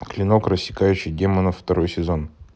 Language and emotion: Russian, neutral